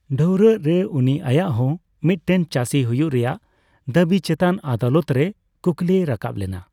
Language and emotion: Santali, neutral